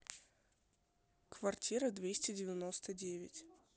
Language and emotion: Russian, neutral